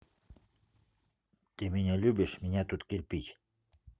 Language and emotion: Russian, neutral